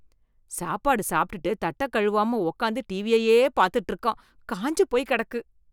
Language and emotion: Tamil, disgusted